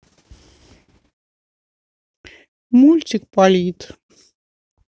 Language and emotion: Russian, sad